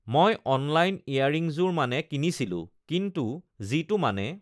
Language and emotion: Assamese, neutral